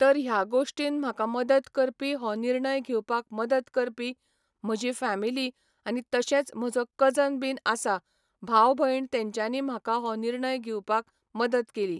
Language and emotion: Goan Konkani, neutral